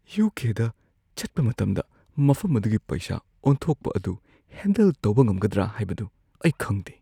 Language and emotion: Manipuri, fearful